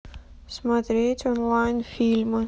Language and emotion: Russian, neutral